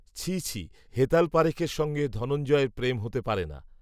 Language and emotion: Bengali, neutral